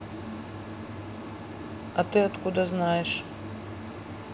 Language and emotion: Russian, neutral